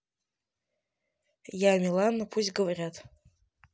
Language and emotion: Russian, neutral